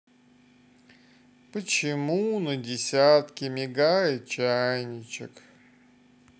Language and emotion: Russian, sad